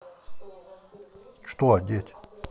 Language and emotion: Russian, angry